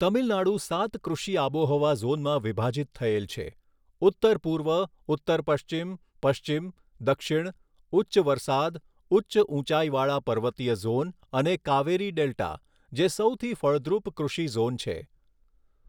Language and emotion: Gujarati, neutral